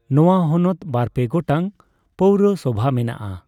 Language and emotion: Santali, neutral